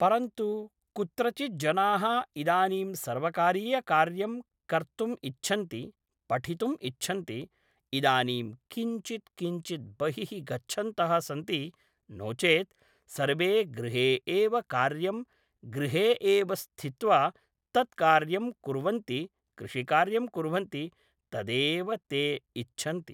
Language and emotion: Sanskrit, neutral